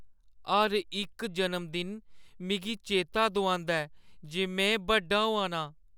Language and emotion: Dogri, sad